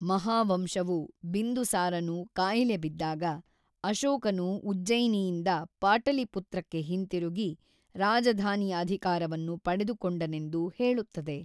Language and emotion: Kannada, neutral